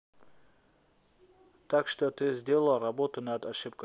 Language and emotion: Russian, neutral